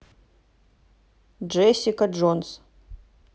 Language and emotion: Russian, neutral